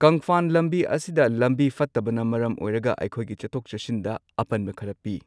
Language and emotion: Manipuri, neutral